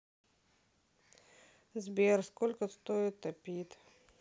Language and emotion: Russian, sad